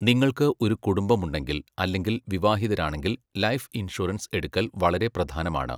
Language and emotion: Malayalam, neutral